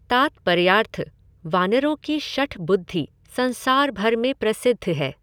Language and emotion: Hindi, neutral